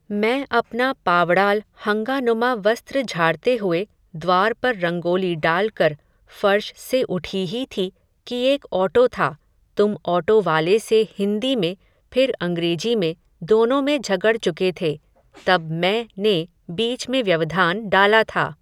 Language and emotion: Hindi, neutral